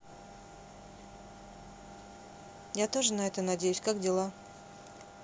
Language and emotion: Russian, neutral